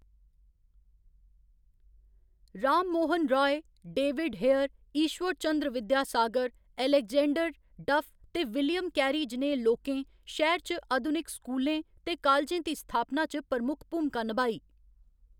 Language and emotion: Dogri, neutral